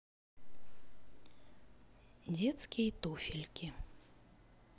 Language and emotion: Russian, neutral